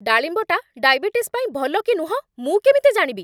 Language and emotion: Odia, angry